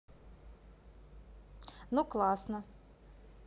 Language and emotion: Russian, positive